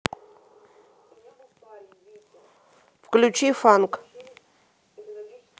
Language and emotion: Russian, neutral